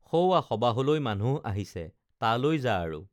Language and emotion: Assamese, neutral